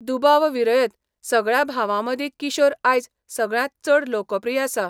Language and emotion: Goan Konkani, neutral